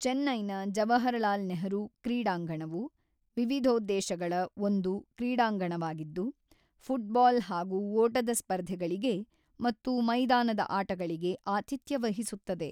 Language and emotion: Kannada, neutral